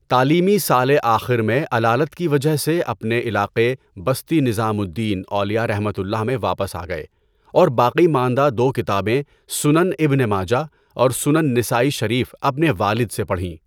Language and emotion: Urdu, neutral